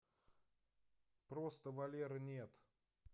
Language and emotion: Russian, neutral